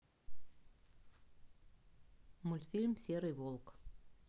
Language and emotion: Russian, neutral